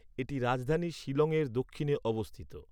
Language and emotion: Bengali, neutral